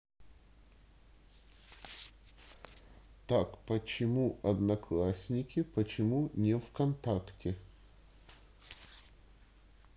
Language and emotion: Russian, neutral